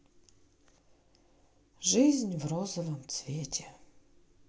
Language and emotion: Russian, sad